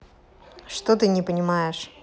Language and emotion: Russian, neutral